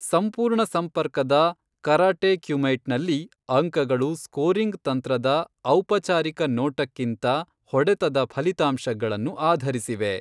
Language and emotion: Kannada, neutral